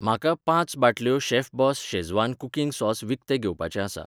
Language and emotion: Goan Konkani, neutral